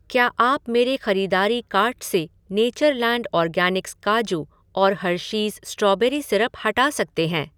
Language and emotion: Hindi, neutral